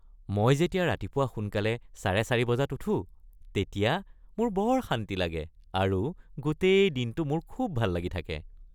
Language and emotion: Assamese, happy